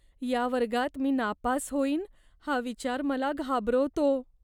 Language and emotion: Marathi, fearful